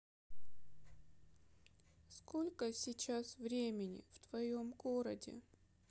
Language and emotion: Russian, sad